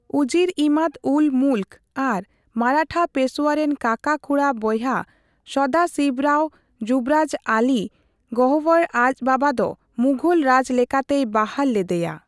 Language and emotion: Santali, neutral